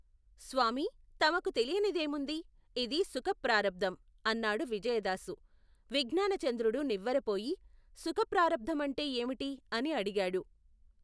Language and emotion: Telugu, neutral